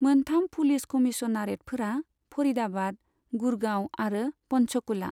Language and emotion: Bodo, neutral